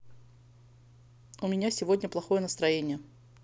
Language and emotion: Russian, neutral